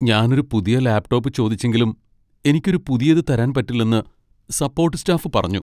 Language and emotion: Malayalam, sad